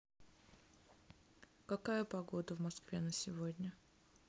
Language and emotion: Russian, neutral